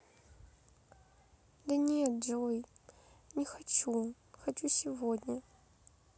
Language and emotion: Russian, sad